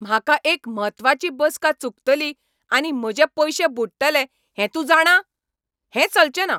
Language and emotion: Goan Konkani, angry